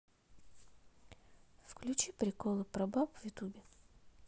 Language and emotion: Russian, neutral